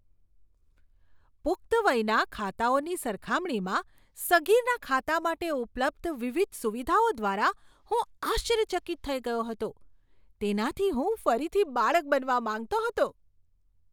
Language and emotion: Gujarati, surprised